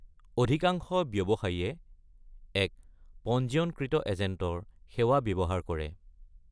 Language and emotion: Assamese, neutral